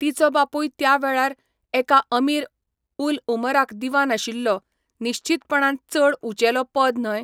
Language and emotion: Goan Konkani, neutral